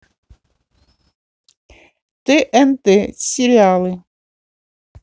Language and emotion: Russian, neutral